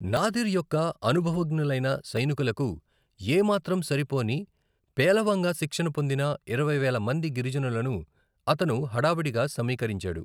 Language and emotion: Telugu, neutral